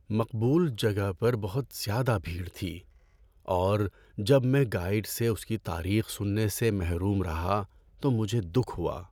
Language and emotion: Urdu, sad